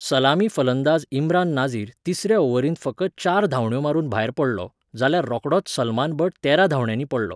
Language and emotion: Goan Konkani, neutral